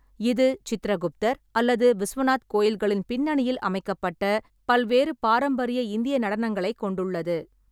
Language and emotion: Tamil, neutral